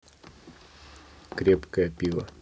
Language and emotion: Russian, neutral